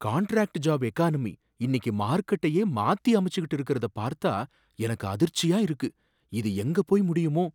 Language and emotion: Tamil, surprised